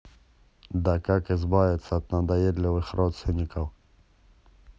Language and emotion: Russian, angry